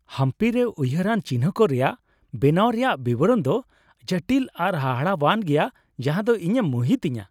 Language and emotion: Santali, happy